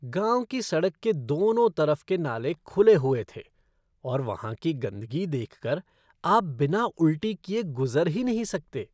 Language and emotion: Hindi, disgusted